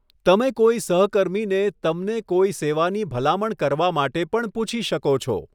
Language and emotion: Gujarati, neutral